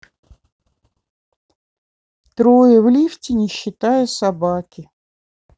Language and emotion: Russian, neutral